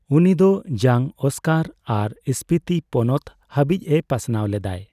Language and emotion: Santali, neutral